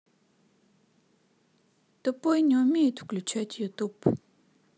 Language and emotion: Russian, sad